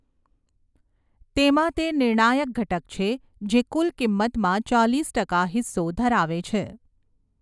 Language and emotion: Gujarati, neutral